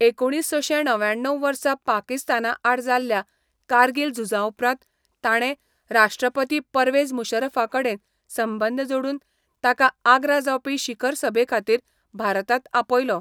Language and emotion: Goan Konkani, neutral